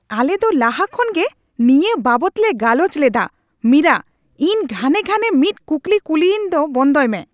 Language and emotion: Santali, angry